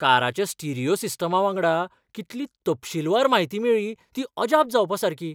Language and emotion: Goan Konkani, surprised